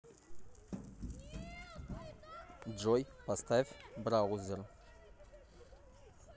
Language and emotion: Russian, neutral